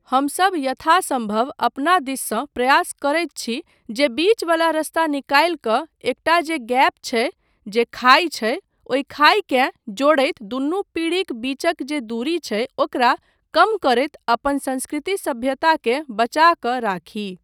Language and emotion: Maithili, neutral